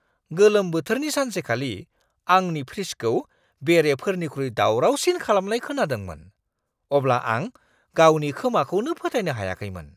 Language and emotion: Bodo, surprised